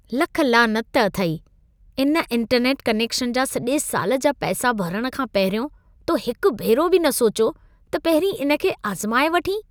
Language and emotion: Sindhi, disgusted